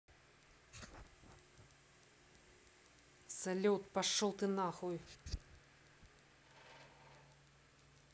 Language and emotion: Russian, angry